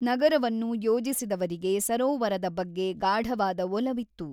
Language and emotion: Kannada, neutral